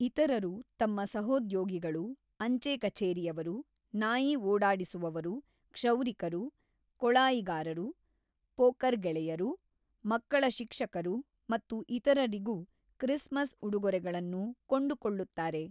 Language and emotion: Kannada, neutral